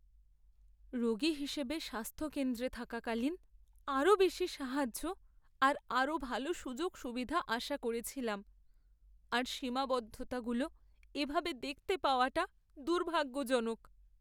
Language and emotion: Bengali, sad